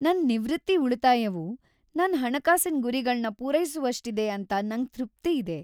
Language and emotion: Kannada, happy